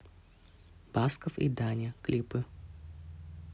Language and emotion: Russian, neutral